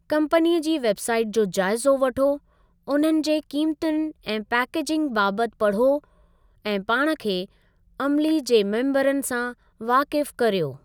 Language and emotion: Sindhi, neutral